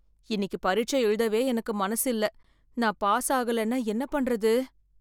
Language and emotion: Tamil, fearful